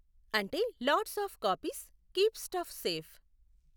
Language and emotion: Telugu, neutral